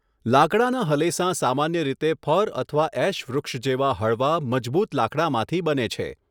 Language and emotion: Gujarati, neutral